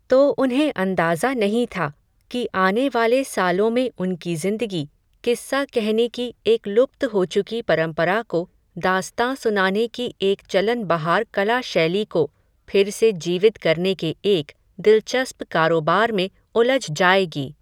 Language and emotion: Hindi, neutral